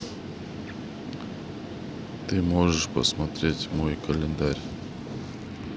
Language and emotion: Russian, neutral